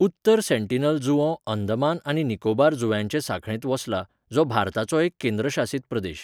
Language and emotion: Goan Konkani, neutral